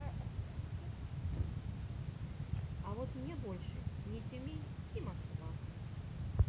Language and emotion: Russian, neutral